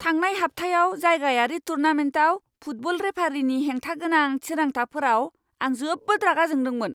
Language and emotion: Bodo, angry